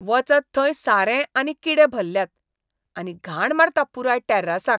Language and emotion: Goan Konkani, disgusted